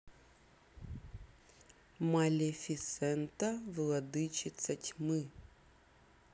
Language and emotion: Russian, neutral